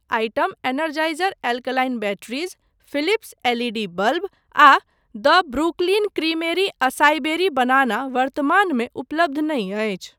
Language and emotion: Maithili, neutral